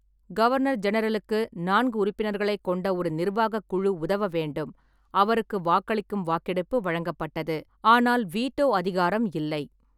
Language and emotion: Tamil, neutral